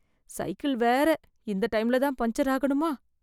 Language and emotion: Tamil, fearful